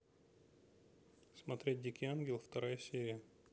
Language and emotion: Russian, neutral